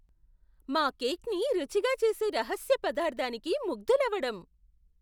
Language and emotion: Telugu, surprised